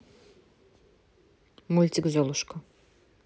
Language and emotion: Russian, neutral